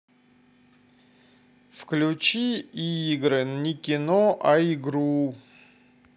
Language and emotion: Russian, neutral